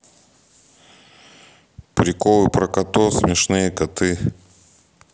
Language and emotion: Russian, neutral